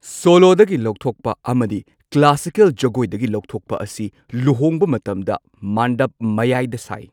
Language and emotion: Manipuri, neutral